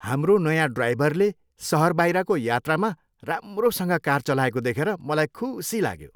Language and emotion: Nepali, happy